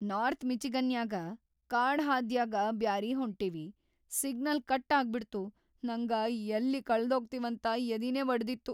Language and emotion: Kannada, fearful